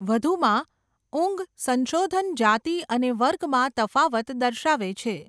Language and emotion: Gujarati, neutral